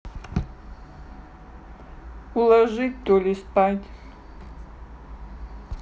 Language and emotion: Russian, neutral